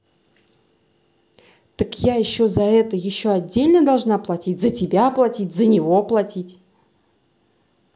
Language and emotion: Russian, angry